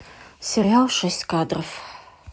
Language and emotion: Russian, neutral